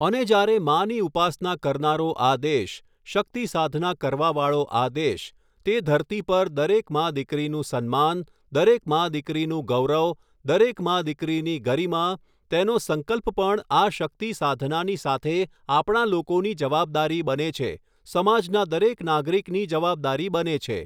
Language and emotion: Gujarati, neutral